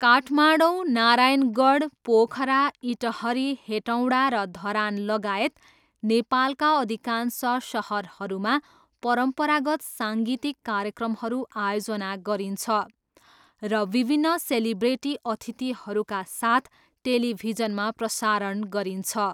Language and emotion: Nepali, neutral